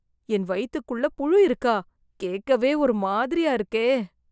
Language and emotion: Tamil, disgusted